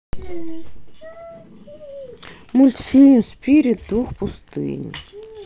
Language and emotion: Russian, neutral